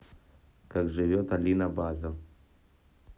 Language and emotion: Russian, neutral